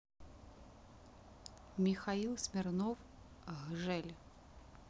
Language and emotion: Russian, neutral